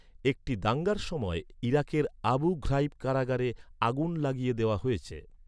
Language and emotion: Bengali, neutral